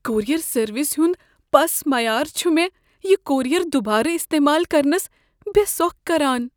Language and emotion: Kashmiri, fearful